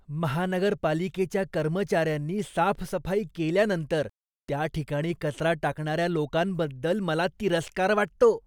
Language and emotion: Marathi, disgusted